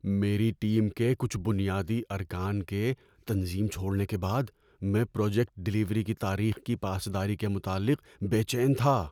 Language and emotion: Urdu, fearful